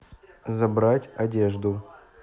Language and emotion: Russian, neutral